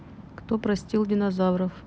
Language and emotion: Russian, neutral